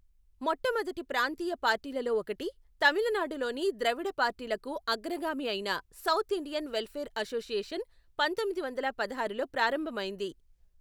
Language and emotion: Telugu, neutral